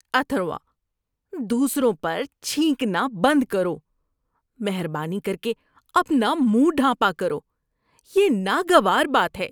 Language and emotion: Urdu, disgusted